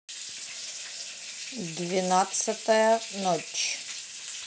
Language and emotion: Russian, neutral